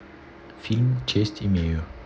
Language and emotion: Russian, neutral